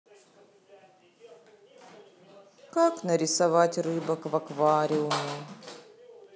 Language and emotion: Russian, sad